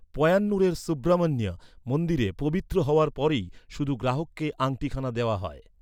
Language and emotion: Bengali, neutral